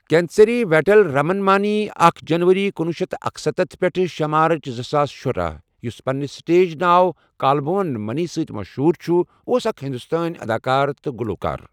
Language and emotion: Kashmiri, neutral